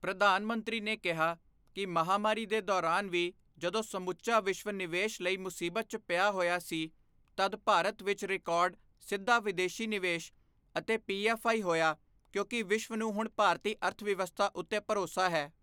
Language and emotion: Punjabi, neutral